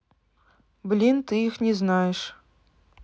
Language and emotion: Russian, neutral